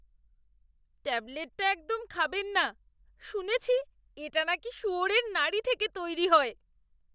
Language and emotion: Bengali, disgusted